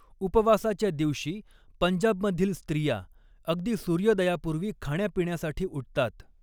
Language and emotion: Marathi, neutral